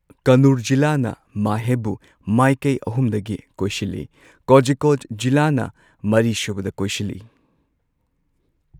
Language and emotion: Manipuri, neutral